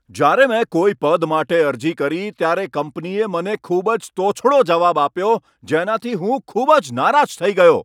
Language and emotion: Gujarati, angry